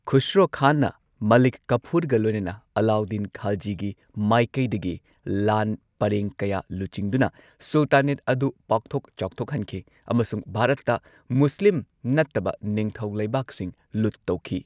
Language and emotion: Manipuri, neutral